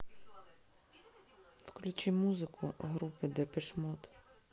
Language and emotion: Russian, neutral